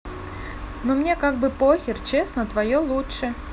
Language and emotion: Russian, neutral